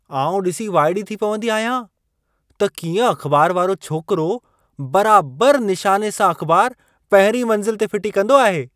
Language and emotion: Sindhi, surprised